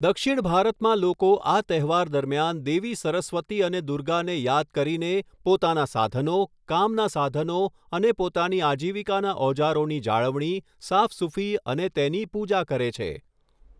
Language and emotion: Gujarati, neutral